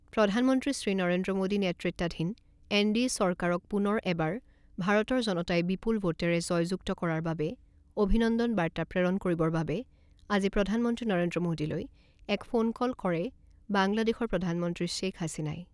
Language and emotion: Assamese, neutral